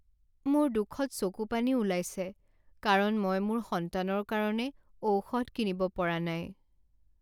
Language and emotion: Assamese, sad